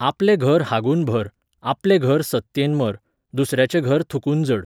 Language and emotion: Goan Konkani, neutral